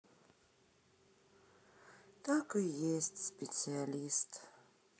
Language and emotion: Russian, sad